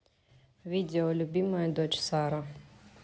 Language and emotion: Russian, neutral